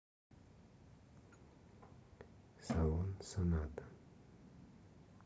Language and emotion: Russian, neutral